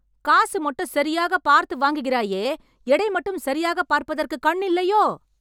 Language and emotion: Tamil, angry